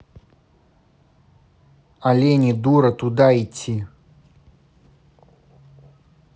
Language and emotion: Russian, angry